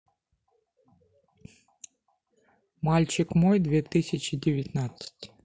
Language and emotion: Russian, neutral